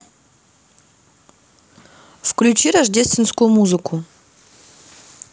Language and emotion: Russian, neutral